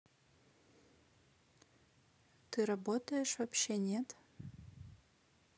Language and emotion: Russian, neutral